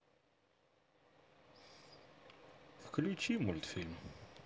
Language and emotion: Russian, sad